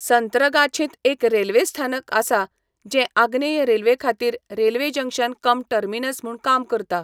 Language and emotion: Goan Konkani, neutral